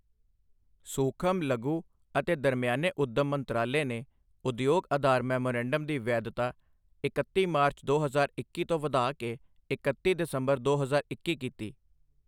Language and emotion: Punjabi, neutral